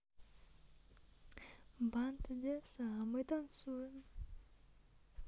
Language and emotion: Russian, neutral